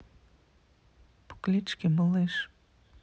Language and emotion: Russian, neutral